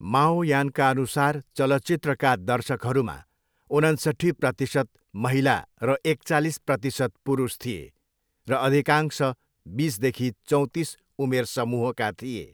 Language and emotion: Nepali, neutral